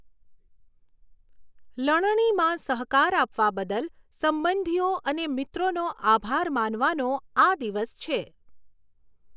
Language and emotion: Gujarati, neutral